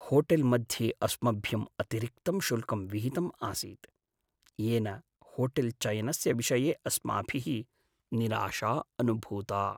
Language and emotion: Sanskrit, sad